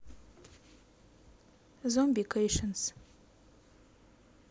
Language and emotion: Russian, neutral